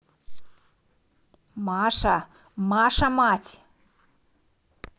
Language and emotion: Russian, neutral